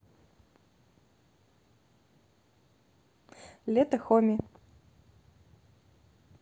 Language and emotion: Russian, neutral